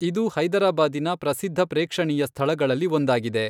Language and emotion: Kannada, neutral